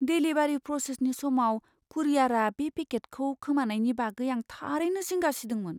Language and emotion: Bodo, fearful